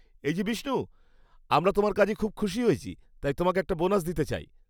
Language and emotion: Bengali, happy